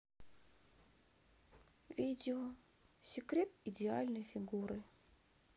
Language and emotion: Russian, sad